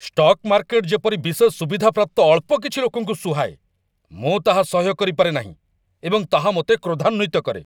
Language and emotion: Odia, angry